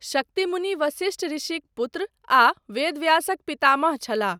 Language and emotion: Maithili, neutral